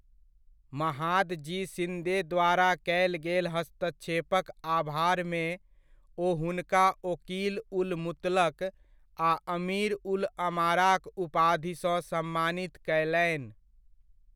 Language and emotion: Maithili, neutral